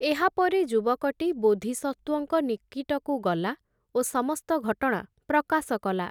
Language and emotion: Odia, neutral